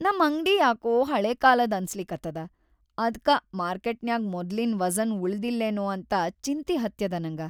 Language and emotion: Kannada, sad